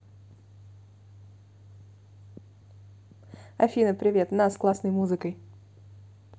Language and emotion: Russian, neutral